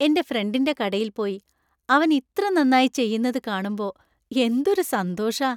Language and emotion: Malayalam, happy